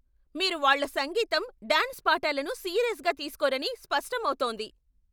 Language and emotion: Telugu, angry